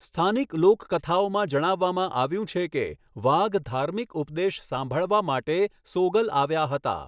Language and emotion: Gujarati, neutral